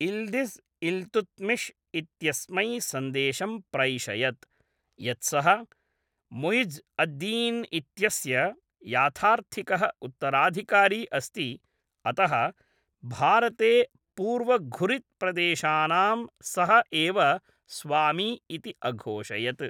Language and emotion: Sanskrit, neutral